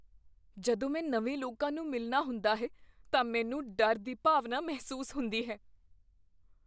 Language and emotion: Punjabi, fearful